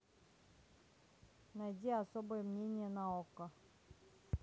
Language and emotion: Russian, neutral